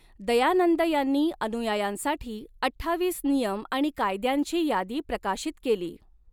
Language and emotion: Marathi, neutral